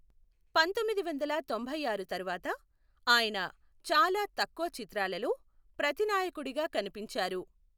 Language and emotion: Telugu, neutral